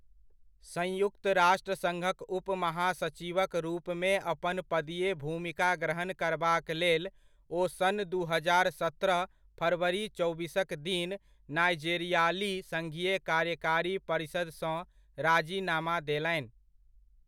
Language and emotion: Maithili, neutral